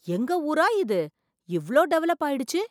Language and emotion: Tamil, surprised